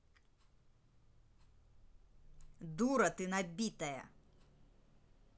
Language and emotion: Russian, angry